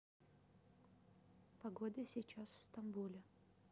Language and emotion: Russian, neutral